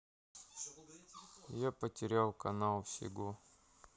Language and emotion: Russian, sad